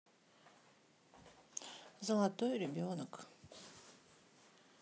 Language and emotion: Russian, sad